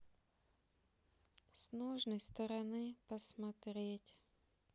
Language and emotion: Russian, sad